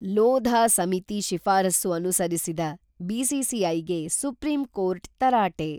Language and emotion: Kannada, neutral